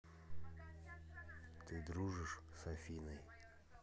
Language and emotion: Russian, neutral